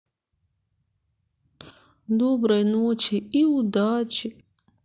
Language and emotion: Russian, sad